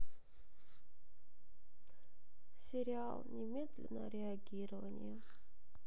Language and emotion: Russian, sad